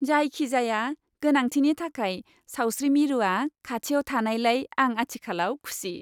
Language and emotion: Bodo, happy